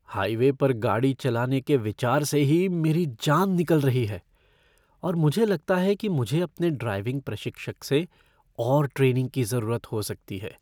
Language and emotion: Hindi, fearful